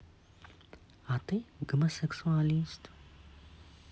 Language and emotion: Russian, neutral